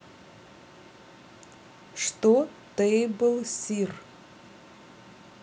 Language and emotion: Russian, neutral